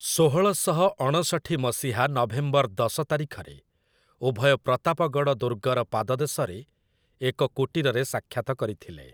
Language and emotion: Odia, neutral